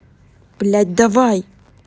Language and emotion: Russian, angry